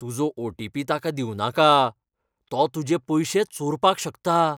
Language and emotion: Goan Konkani, fearful